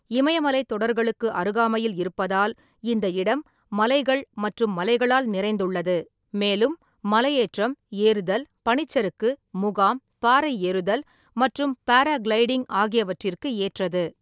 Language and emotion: Tamil, neutral